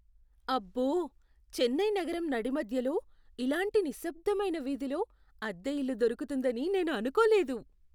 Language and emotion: Telugu, surprised